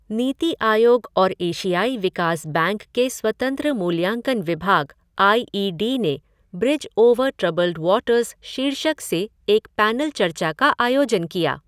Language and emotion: Hindi, neutral